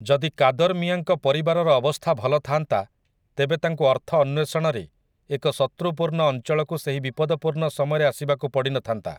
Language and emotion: Odia, neutral